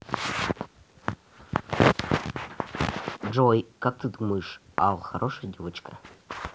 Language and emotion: Russian, neutral